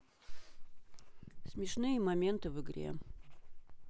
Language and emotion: Russian, neutral